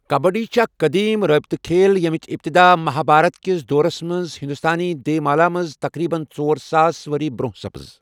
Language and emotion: Kashmiri, neutral